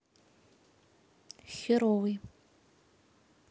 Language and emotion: Russian, neutral